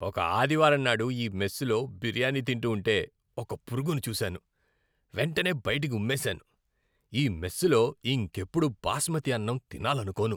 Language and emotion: Telugu, disgusted